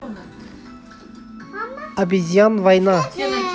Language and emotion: Russian, neutral